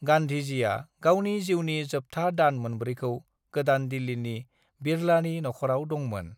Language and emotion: Bodo, neutral